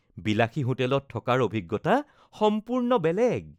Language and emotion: Assamese, happy